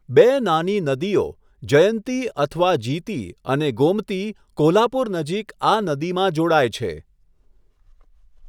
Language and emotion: Gujarati, neutral